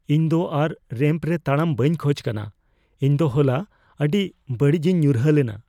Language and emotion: Santali, fearful